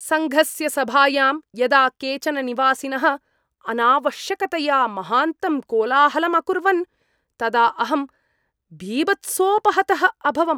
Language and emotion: Sanskrit, disgusted